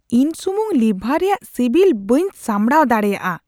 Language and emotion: Santali, disgusted